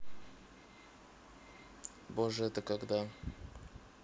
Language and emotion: Russian, neutral